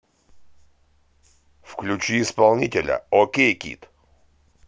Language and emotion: Russian, positive